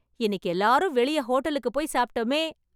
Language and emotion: Tamil, happy